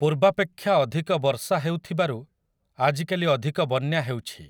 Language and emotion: Odia, neutral